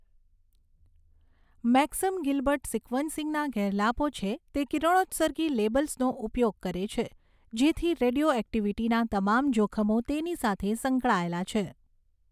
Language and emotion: Gujarati, neutral